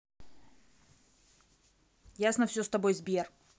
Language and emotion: Russian, angry